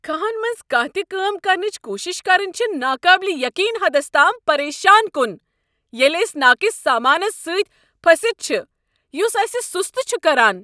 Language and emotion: Kashmiri, angry